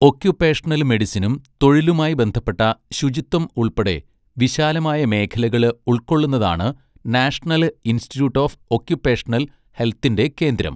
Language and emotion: Malayalam, neutral